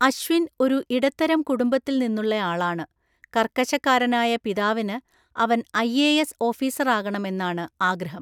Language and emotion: Malayalam, neutral